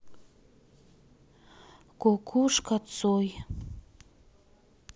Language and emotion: Russian, sad